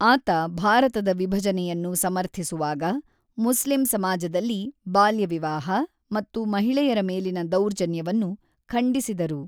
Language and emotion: Kannada, neutral